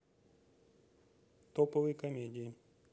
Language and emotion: Russian, neutral